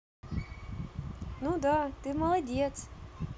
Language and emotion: Russian, positive